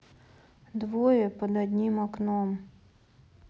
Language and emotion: Russian, sad